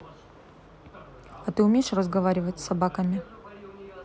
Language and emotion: Russian, neutral